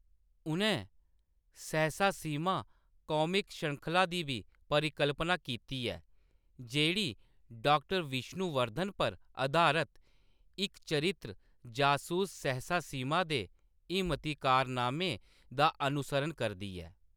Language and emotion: Dogri, neutral